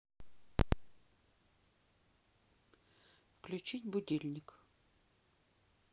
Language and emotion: Russian, neutral